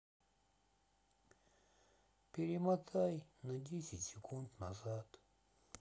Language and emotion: Russian, sad